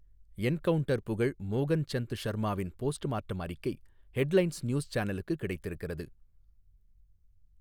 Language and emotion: Tamil, neutral